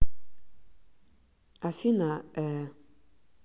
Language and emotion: Russian, neutral